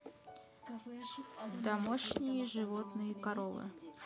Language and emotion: Russian, neutral